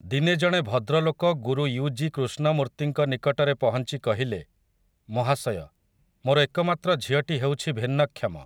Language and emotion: Odia, neutral